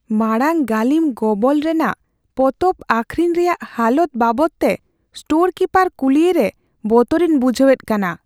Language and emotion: Santali, fearful